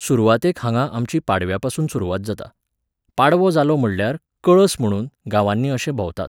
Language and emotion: Goan Konkani, neutral